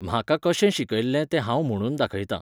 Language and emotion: Goan Konkani, neutral